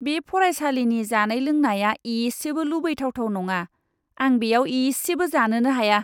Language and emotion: Bodo, disgusted